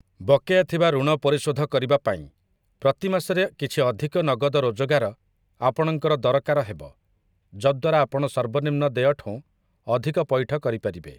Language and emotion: Odia, neutral